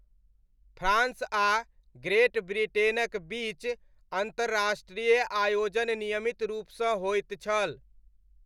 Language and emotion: Maithili, neutral